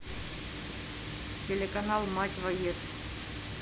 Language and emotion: Russian, neutral